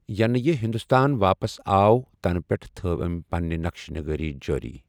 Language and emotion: Kashmiri, neutral